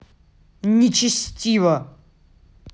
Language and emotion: Russian, angry